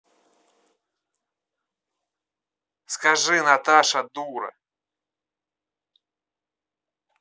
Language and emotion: Russian, neutral